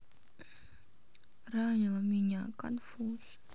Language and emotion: Russian, sad